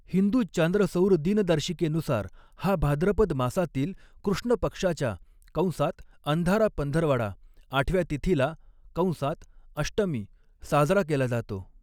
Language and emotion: Marathi, neutral